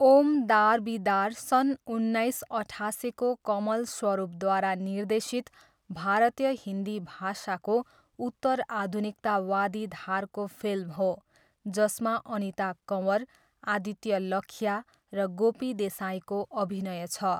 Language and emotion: Nepali, neutral